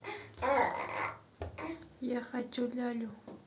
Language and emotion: Russian, neutral